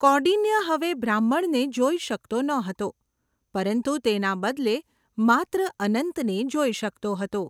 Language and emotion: Gujarati, neutral